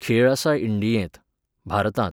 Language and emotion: Goan Konkani, neutral